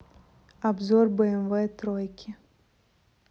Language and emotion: Russian, neutral